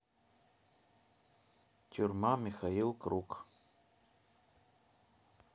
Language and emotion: Russian, neutral